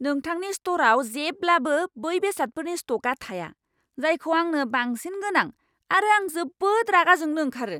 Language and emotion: Bodo, angry